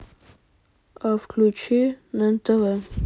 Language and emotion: Russian, neutral